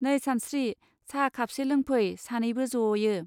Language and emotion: Bodo, neutral